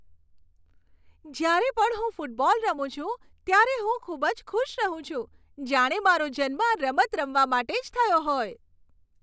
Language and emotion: Gujarati, happy